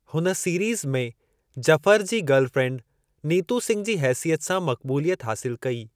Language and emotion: Sindhi, neutral